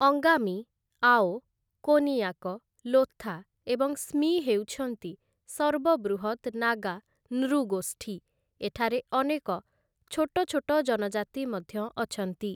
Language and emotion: Odia, neutral